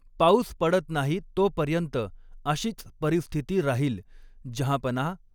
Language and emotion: Marathi, neutral